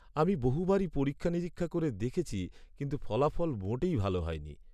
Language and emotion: Bengali, sad